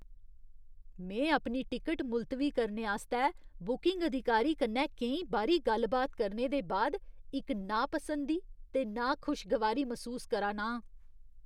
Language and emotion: Dogri, disgusted